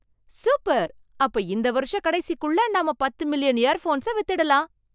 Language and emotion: Tamil, surprised